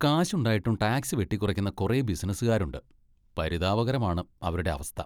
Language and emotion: Malayalam, disgusted